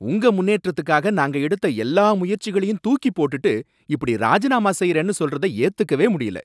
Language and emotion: Tamil, angry